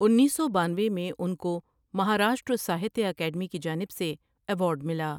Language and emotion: Urdu, neutral